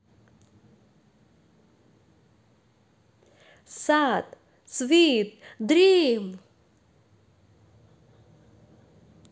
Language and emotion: Russian, positive